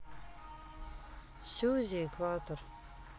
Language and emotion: Russian, sad